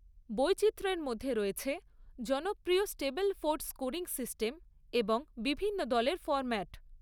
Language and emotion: Bengali, neutral